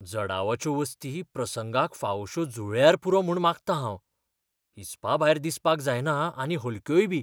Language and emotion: Goan Konkani, fearful